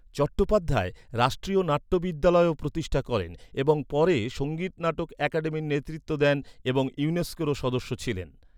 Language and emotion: Bengali, neutral